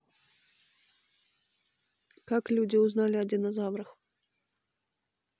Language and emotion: Russian, neutral